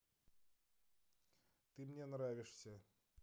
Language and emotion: Russian, neutral